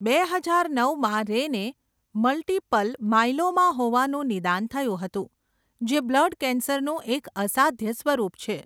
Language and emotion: Gujarati, neutral